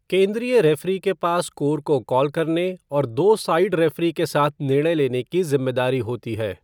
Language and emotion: Hindi, neutral